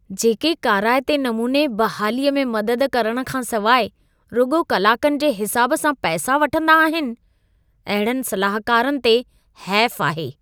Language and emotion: Sindhi, disgusted